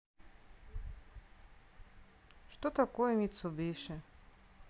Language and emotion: Russian, sad